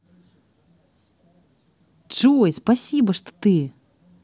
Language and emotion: Russian, positive